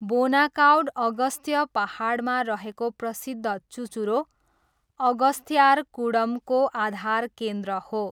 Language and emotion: Nepali, neutral